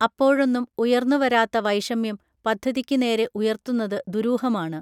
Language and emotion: Malayalam, neutral